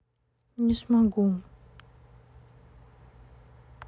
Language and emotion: Russian, sad